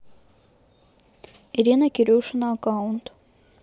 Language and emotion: Russian, neutral